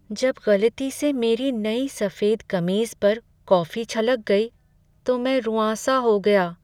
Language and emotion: Hindi, sad